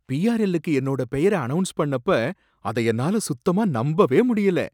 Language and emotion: Tamil, surprised